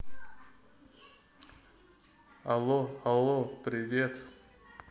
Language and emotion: Russian, neutral